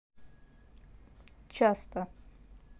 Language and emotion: Russian, neutral